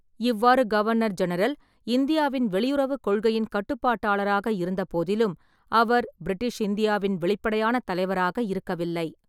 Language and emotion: Tamil, neutral